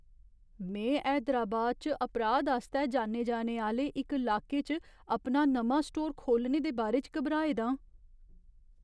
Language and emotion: Dogri, fearful